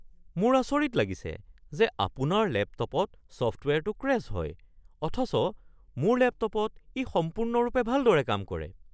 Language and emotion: Assamese, surprised